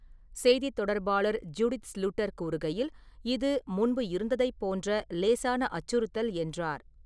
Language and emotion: Tamil, neutral